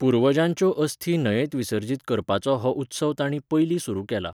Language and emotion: Goan Konkani, neutral